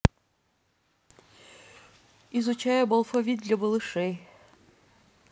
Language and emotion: Russian, neutral